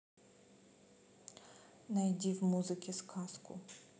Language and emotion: Russian, neutral